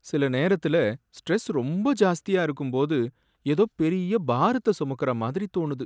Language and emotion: Tamil, sad